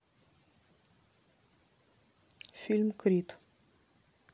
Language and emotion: Russian, neutral